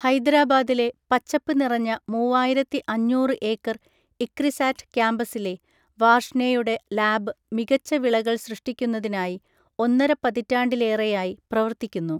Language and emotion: Malayalam, neutral